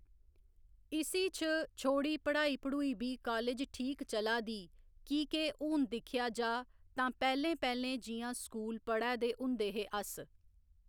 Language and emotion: Dogri, neutral